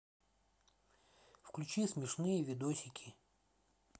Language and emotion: Russian, neutral